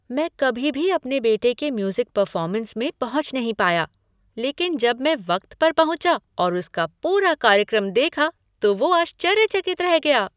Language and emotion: Hindi, surprised